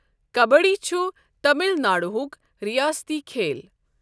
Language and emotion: Kashmiri, neutral